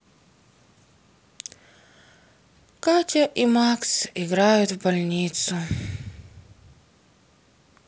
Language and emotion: Russian, sad